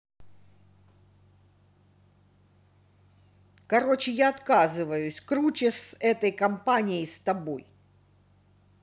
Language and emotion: Russian, angry